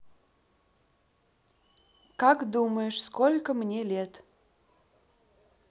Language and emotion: Russian, neutral